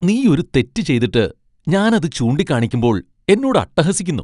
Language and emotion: Malayalam, disgusted